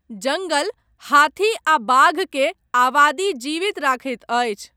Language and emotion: Maithili, neutral